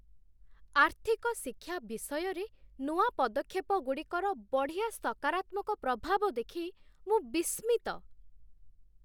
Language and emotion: Odia, surprised